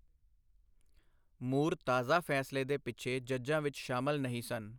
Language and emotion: Punjabi, neutral